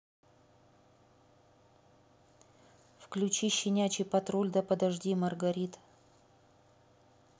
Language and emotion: Russian, neutral